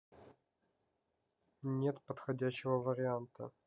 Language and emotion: Russian, neutral